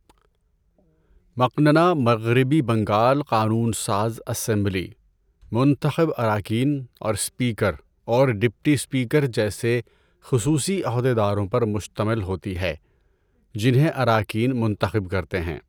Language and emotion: Urdu, neutral